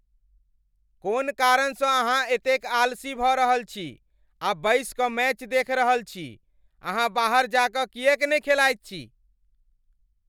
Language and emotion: Maithili, angry